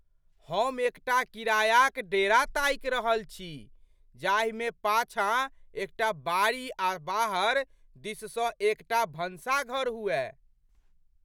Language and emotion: Maithili, surprised